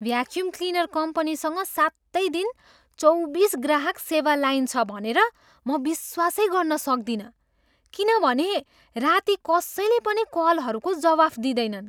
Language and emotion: Nepali, surprised